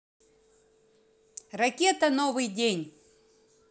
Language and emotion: Russian, positive